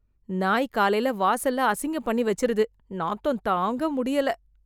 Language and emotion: Tamil, disgusted